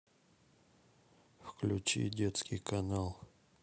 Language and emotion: Russian, sad